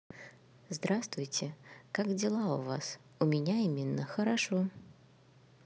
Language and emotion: Russian, neutral